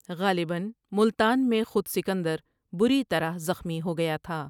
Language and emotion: Urdu, neutral